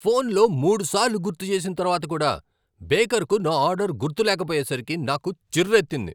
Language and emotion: Telugu, angry